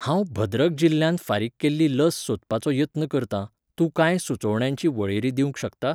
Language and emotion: Goan Konkani, neutral